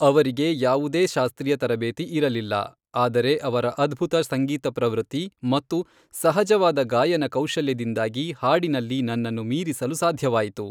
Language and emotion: Kannada, neutral